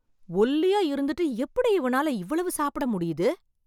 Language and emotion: Tamil, surprised